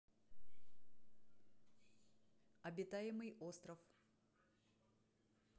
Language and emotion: Russian, neutral